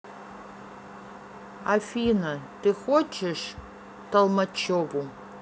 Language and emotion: Russian, neutral